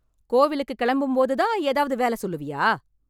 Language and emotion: Tamil, angry